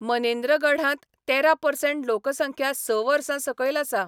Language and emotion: Goan Konkani, neutral